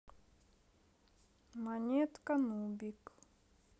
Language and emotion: Russian, sad